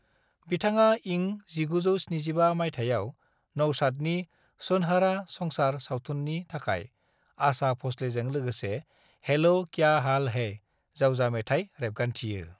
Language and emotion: Bodo, neutral